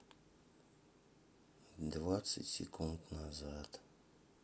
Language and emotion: Russian, sad